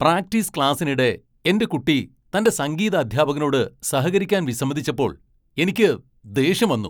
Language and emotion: Malayalam, angry